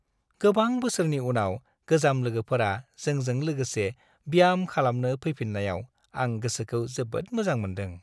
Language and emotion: Bodo, happy